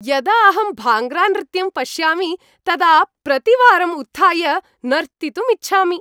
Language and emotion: Sanskrit, happy